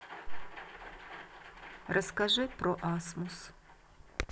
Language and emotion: Russian, neutral